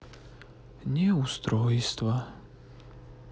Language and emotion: Russian, sad